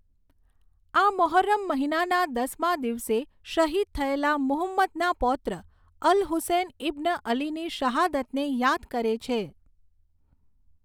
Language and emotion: Gujarati, neutral